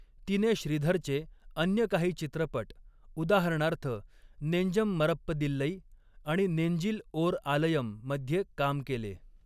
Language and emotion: Marathi, neutral